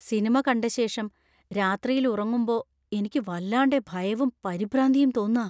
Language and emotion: Malayalam, fearful